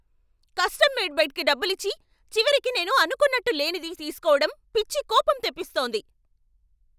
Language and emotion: Telugu, angry